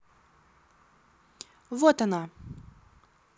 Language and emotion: Russian, neutral